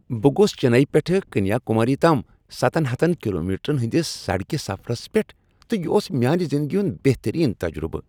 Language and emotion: Kashmiri, happy